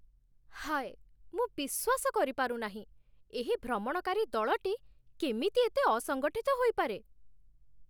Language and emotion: Odia, disgusted